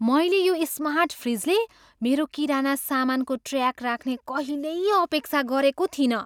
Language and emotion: Nepali, surprised